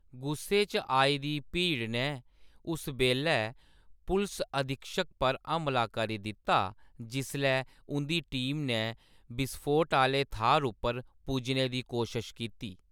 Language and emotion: Dogri, neutral